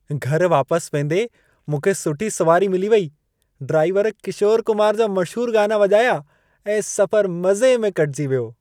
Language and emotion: Sindhi, happy